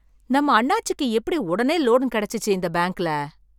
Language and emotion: Tamil, surprised